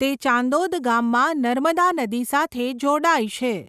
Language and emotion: Gujarati, neutral